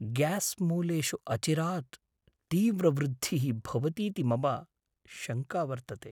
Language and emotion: Sanskrit, fearful